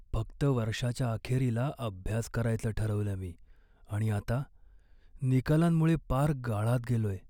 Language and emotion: Marathi, sad